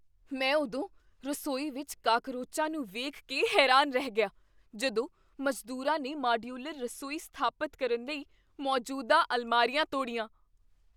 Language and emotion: Punjabi, surprised